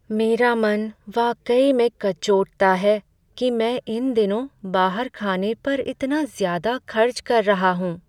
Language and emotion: Hindi, sad